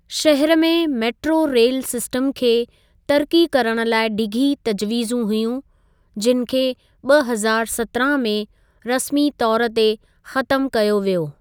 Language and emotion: Sindhi, neutral